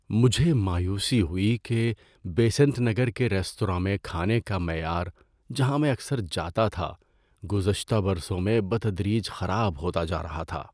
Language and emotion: Urdu, sad